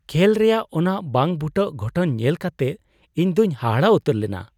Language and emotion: Santali, surprised